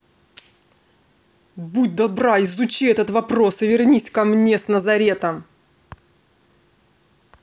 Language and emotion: Russian, angry